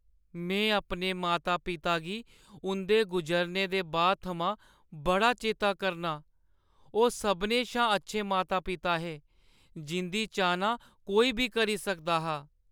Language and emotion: Dogri, sad